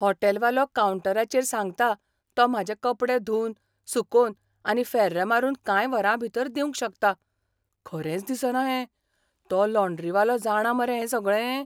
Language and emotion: Goan Konkani, surprised